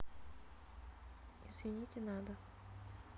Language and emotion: Russian, neutral